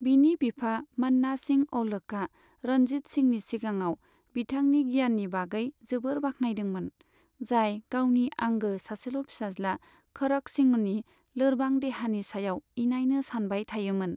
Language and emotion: Bodo, neutral